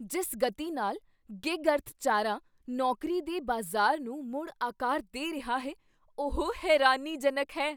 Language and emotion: Punjabi, surprised